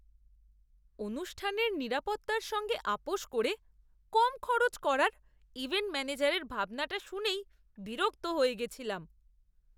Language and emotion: Bengali, disgusted